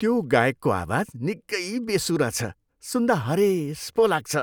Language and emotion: Nepali, disgusted